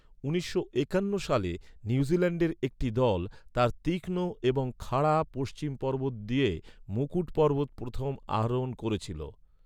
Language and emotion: Bengali, neutral